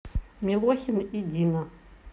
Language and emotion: Russian, neutral